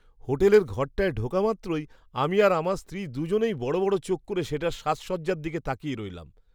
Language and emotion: Bengali, surprised